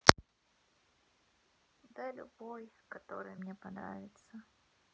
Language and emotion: Russian, sad